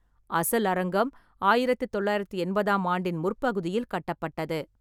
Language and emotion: Tamil, neutral